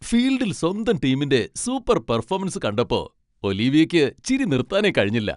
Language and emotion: Malayalam, happy